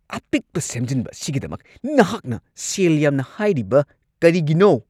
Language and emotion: Manipuri, angry